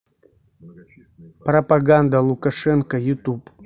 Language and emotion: Russian, neutral